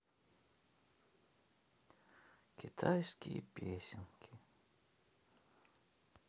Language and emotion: Russian, sad